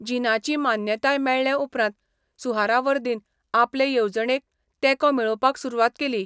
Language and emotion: Goan Konkani, neutral